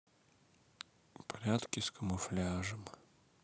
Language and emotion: Russian, sad